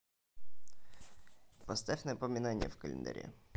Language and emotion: Russian, neutral